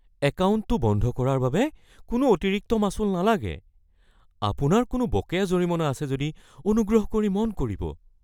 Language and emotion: Assamese, fearful